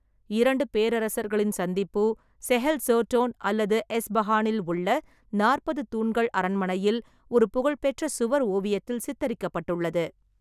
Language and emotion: Tamil, neutral